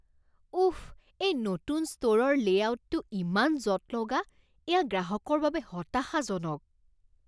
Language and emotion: Assamese, disgusted